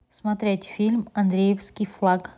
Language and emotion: Russian, neutral